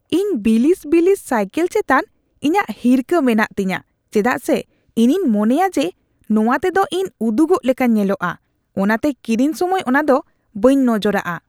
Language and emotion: Santali, disgusted